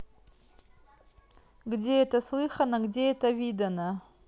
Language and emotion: Russian, neutral